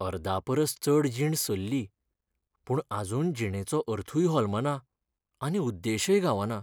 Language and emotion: Goan Konkani, sad